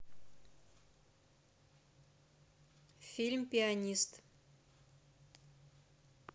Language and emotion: Russian, neutral